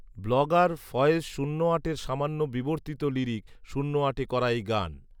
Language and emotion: Bengali, neutral